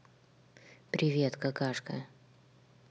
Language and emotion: Russian, neutral